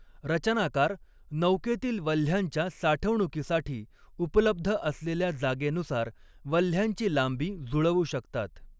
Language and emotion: Marathi, neutral